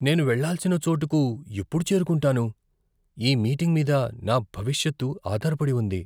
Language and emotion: Telugu, fearful